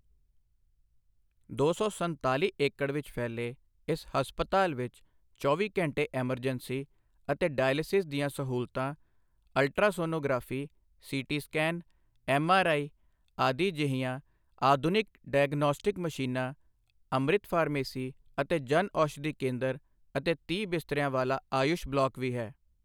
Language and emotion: Punjabi, neutral